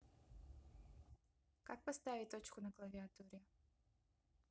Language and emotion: Russian, neutral